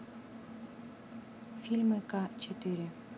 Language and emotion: Russian, neutral